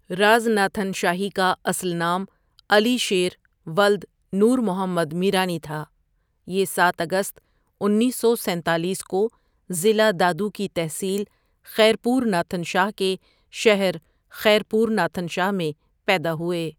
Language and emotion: Urdu, neutral